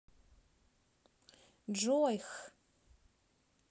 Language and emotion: Russian, neutral